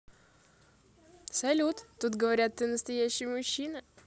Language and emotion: Russian, positive